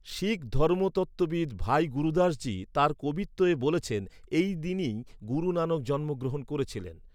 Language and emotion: Bengali, neutral